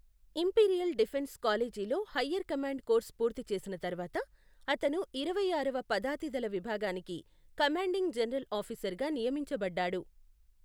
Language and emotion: Telugu, neutral